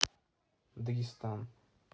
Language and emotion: Russian, neutral